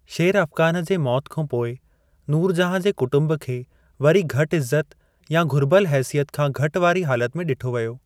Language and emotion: Sindhi, neutral